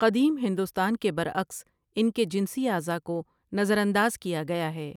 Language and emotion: Urdu, neutral